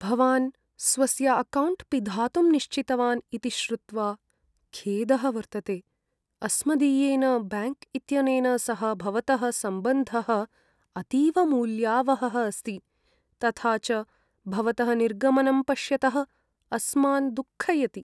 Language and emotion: Sanskrit, sad